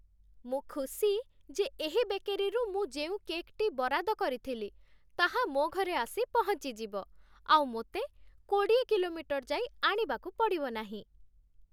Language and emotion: Odia, happy